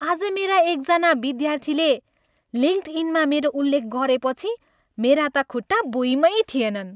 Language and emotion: Nepali, happy